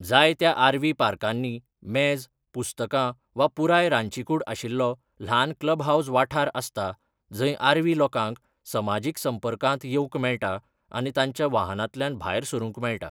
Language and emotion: Goan Konkani, neutral